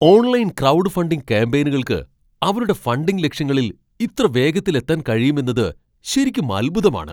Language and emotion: Malayalam, surprised